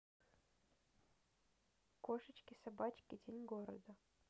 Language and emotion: Russian, neutral